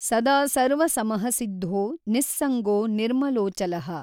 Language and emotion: Kannada, neutral